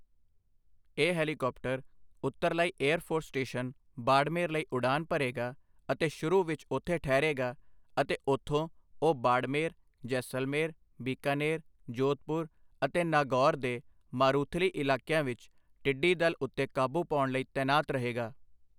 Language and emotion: Punjabi, neutral